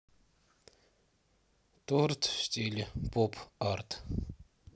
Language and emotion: Russian, neutral